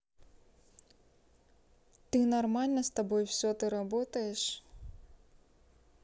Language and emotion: Russian, neutral